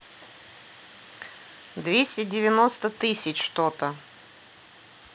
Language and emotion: Russian, neutral